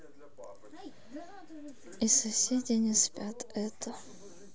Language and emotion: Russian, sad